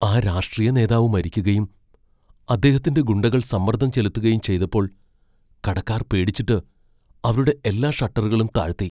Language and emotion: Malayalam, fearful